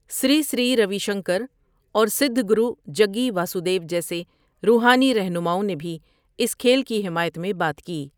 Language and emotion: Urdu, neutral